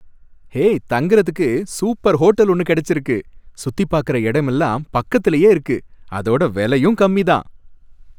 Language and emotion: Tamil, happy